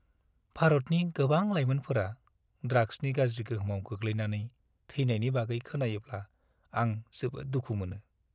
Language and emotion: Bodo, sad